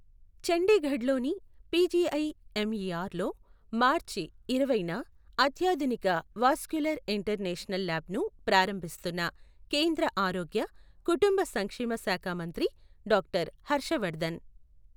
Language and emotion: Telugu, neutral